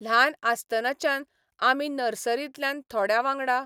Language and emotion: Goan Konkani, neutral